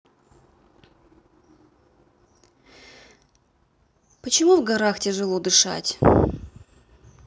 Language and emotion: Russian, neutral